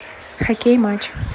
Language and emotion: Russian, neutral